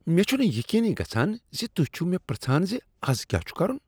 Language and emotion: Kashmiri, disgusted